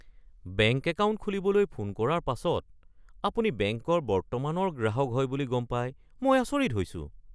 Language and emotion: Assamese, surprised